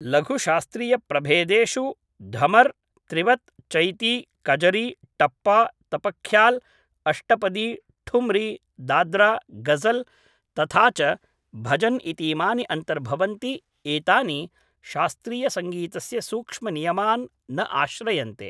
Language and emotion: Sanskrit, neutral